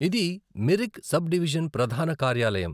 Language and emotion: Telugu, neutral